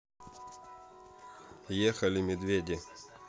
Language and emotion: Russian, neutral